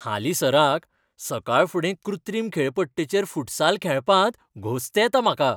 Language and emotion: Goan Konkani, happy